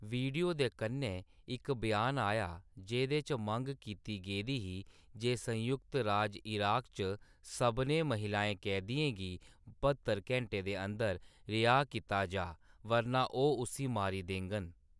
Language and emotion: Dogri, neutral